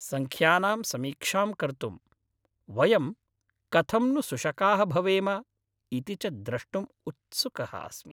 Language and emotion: Sanskrit, happy